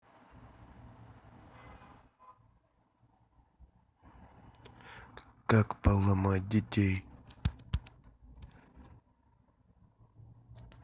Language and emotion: Russian, neutral